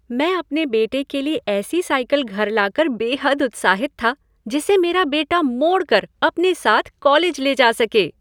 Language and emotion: Hindi, happy